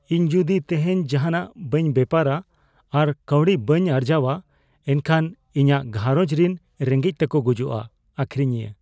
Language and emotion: Santali, fearful